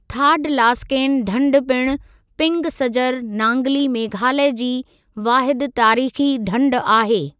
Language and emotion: Sindhi, neutral